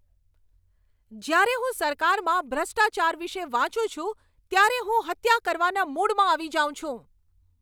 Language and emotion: Gujarati, angry